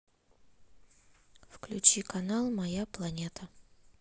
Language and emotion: Russian, neutral